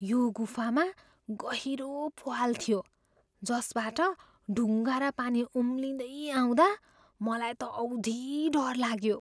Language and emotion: Nepali, fearful